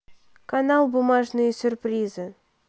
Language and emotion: Russian, neutral